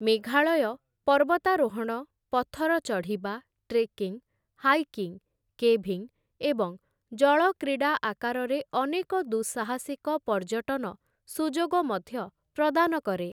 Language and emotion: Odia, neutral